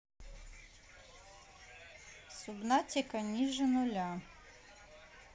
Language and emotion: Russian, neutral